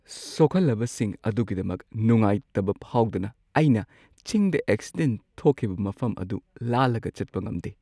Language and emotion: Manipuri, sad